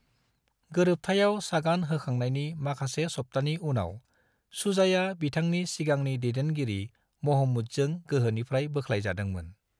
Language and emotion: Bodo, neutral